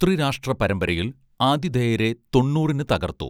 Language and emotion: Malayalam, neutral